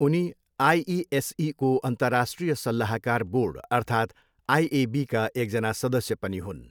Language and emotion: Nepali, neutral